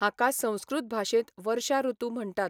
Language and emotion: Goan Konkani, neutral